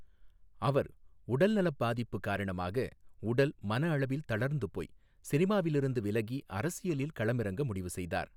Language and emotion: Tamil, neutral